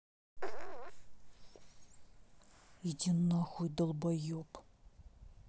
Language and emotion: Russian, angry